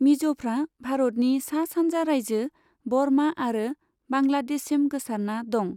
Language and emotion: Bodo, neutral